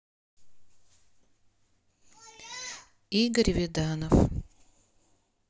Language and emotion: Russian, neutral